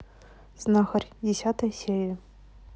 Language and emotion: Russian, neutral